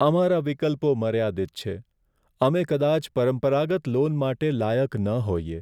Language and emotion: Gujarati, sad